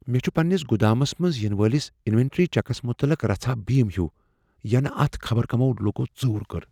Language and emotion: Kashmiri, fearful